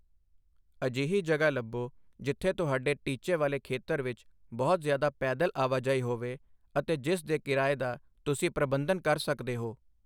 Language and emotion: Punjabi, neutral